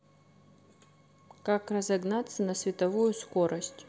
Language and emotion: Russian, neutral